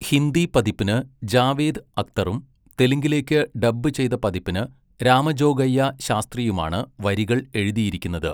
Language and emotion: Malayalam, neutral